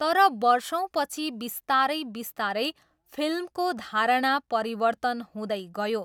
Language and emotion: Nepali, neutral